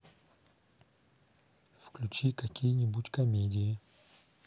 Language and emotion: Russian, neutral